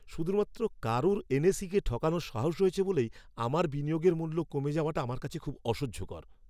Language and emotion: Bengali, angry